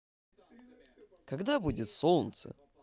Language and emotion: Russian, positive